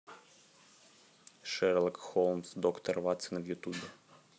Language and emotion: Russian, neutral